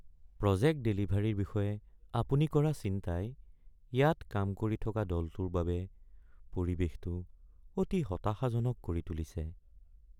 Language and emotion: Assamese, sad